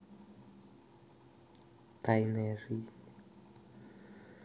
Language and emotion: Russian, neutral